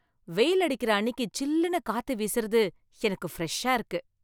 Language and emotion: Tamil, happy